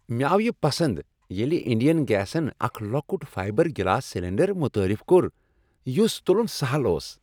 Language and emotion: Kashmiri, happy